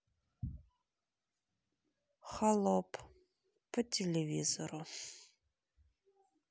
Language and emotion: Russian, sad